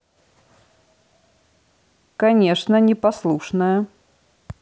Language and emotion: Russian, neutral